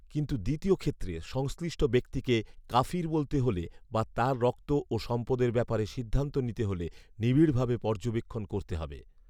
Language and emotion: Bengali, neutral